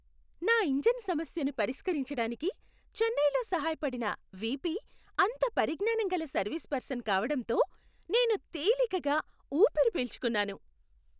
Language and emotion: Telugu, happy